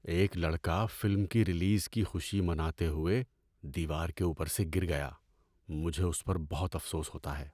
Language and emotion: Urdu, sad